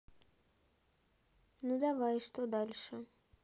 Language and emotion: Russian, neutral